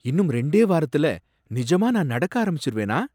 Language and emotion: Tamil, surprised